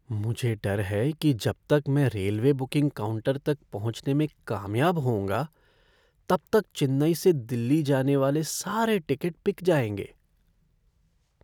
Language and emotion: Hindi, fearful